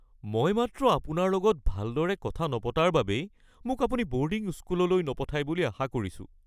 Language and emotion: Assamese, fearful